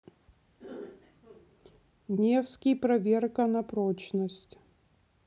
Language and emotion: Russian, neutral